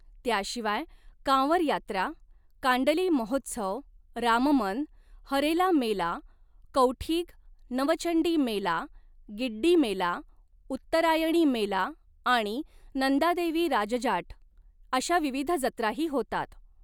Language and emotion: Marathi, neutral